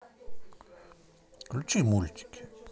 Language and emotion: Russian, neutral